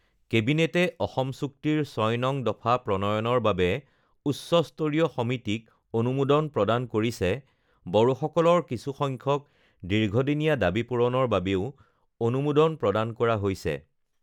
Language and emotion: Assamese, neutral